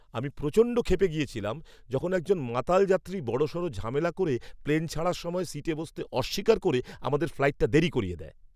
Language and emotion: Bengali, angry